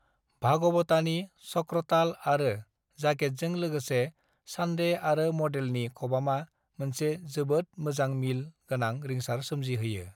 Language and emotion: Bodo, neutral